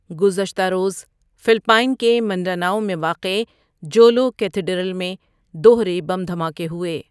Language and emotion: Urdu, neutral